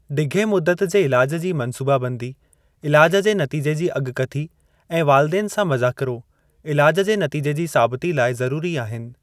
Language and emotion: Sindhi, neutral